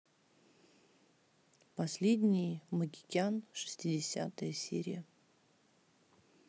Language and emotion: Russian, neutral